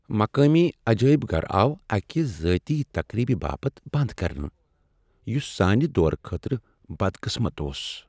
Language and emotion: Kashmiri, sad